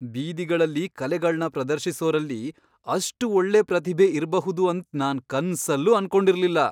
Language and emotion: Kannada, surprised